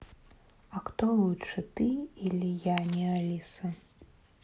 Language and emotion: Russian, neutral